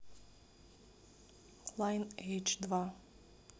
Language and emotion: Russian, neutral